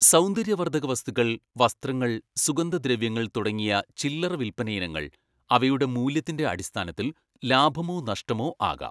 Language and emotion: Malayalam, neutral